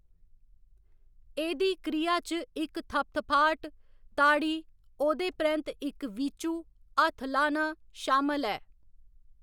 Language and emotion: Dogri, neutral